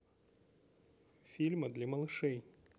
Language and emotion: Russian, neutral